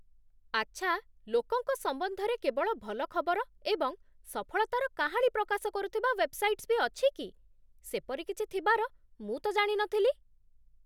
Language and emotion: Odia, surprised